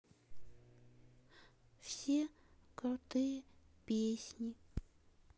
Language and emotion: Russian, sad